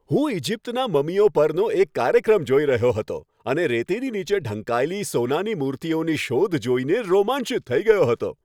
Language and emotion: Gujarati, happy